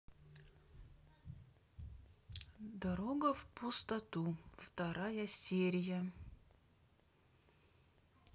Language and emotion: Russian, neutral